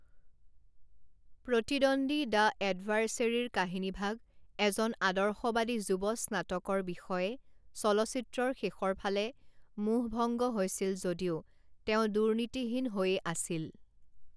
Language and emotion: Assamese, neutral